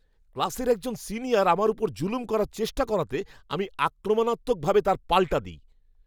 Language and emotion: Bengali, angry